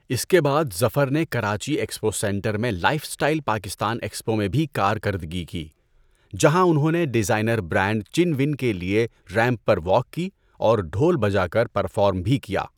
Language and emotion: Urdu, neutral